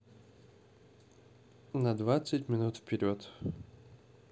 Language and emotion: Russian, neutral